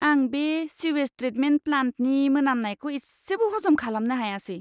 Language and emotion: Bodo, disgusted